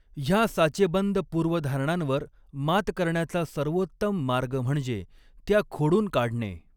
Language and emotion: Marathi, neutral